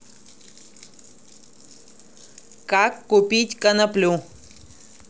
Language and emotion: Russian, neutral